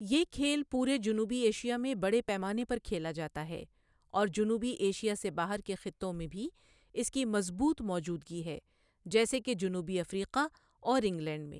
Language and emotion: Urdu, neutral